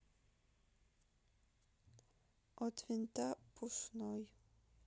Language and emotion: Russian, sad